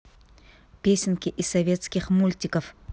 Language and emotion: Russian, angry